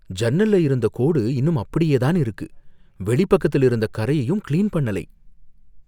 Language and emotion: Tamil, fearful